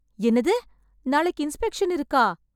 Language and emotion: Tamil, surprised